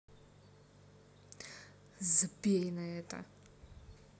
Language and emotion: Russian, angry